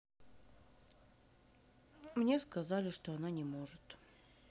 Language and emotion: Russian, sad